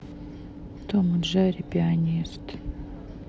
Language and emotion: Russian, sad